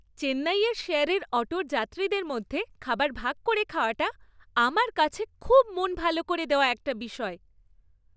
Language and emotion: Bengali, happy